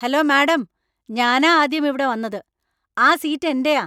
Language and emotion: Malayalam, angry